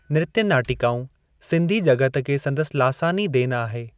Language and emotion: Sindhi, neutral